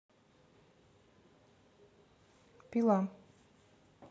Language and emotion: Russian, neutral